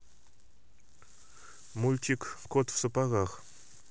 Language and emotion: Russian, neutral